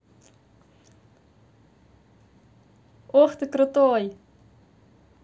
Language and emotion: Russian, positive